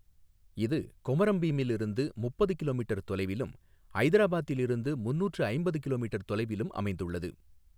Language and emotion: Tamil, neutral